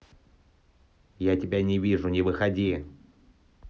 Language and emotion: Russian, angry